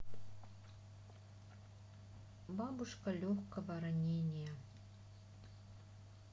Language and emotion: Russian, sad